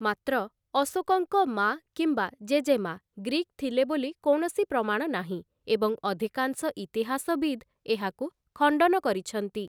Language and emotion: Odia, neutral